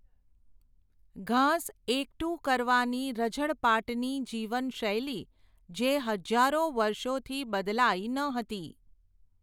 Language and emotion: Gujarati, neutral